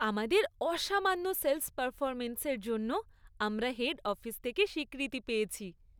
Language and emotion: Bengali, happy